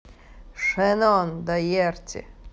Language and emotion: Russian, neutral